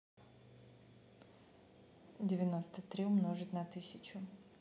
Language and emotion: Russian, neutral